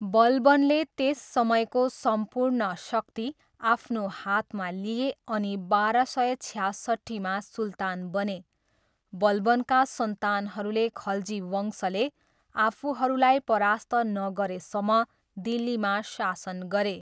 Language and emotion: Nepali, neutral